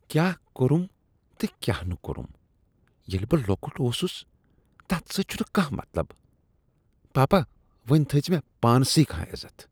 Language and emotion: Kashmiri, disgusted